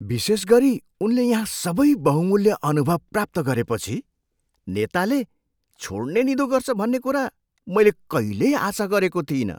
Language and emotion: Nepali, surprised